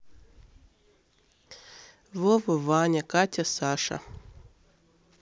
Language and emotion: Russian, neutral